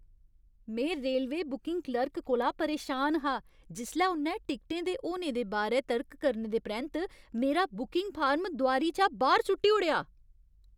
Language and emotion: Dogri, angry